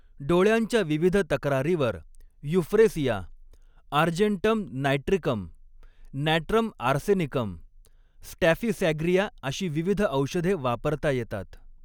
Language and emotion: Marathi, neutral